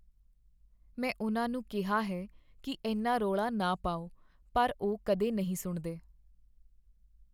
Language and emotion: Punjabi, sad